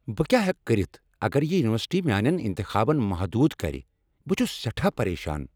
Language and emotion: Kashmiri, angry